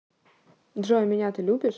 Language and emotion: Russian, neutral